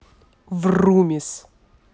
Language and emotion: Russian, angry